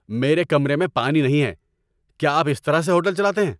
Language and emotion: Urdu, angry